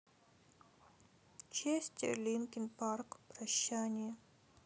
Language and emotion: Russian, sad